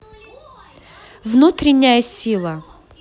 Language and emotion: Russian, neutral